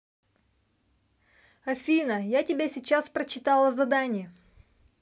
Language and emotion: Russian, neutral